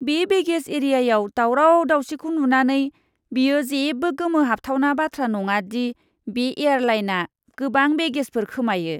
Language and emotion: Bodo, disgusted